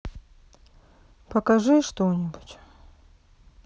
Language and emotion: Russian, sad